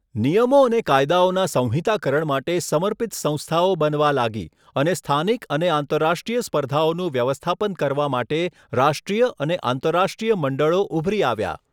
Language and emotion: Gujarati, neutral